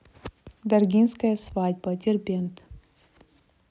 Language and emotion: Russian, neutral